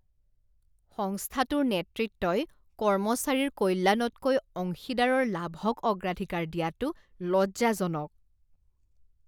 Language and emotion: Assamese, disgusted